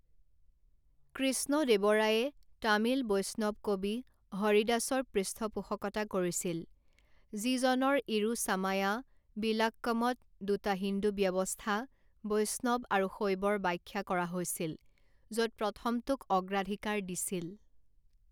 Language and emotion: Assamese, neutral